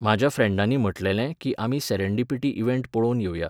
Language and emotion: Goan Konkani, neutral